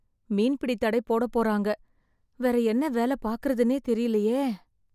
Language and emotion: Tamil, fearful